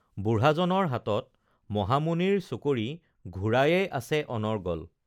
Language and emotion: Assamese, neutral